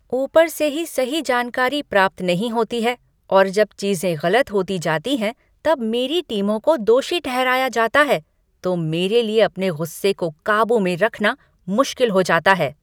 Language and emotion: Hindi, angry